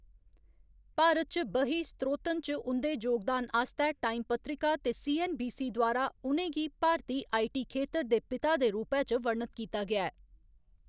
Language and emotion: Dogri, neutral